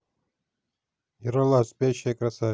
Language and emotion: Russian, neutral